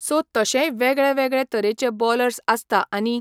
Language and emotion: Goan Konkani, neutral